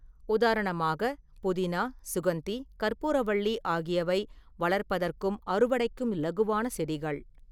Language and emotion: Tamil, neutral